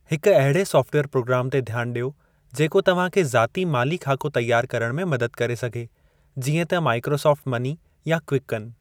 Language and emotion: Sindhi, neutral